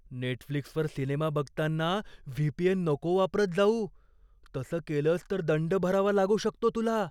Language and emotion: Marathi, fearful